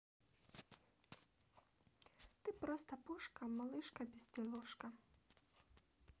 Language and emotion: Russian, neutral